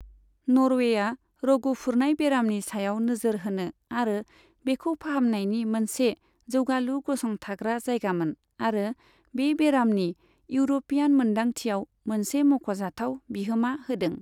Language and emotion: Bodo, neutral